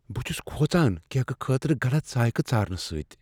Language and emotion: Kashmiri, fearful